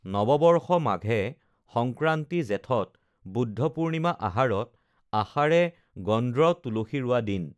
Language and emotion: Assamese, neutral